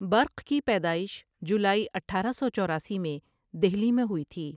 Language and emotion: Urdu, neutral